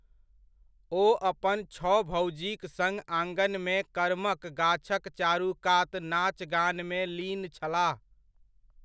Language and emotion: Maithili, neutral